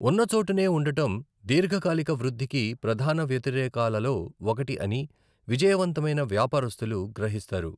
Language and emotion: Telugu, neutral